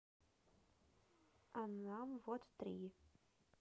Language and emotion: Russian, neutral